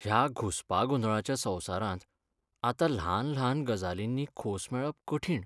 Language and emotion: Goan Konkani, sad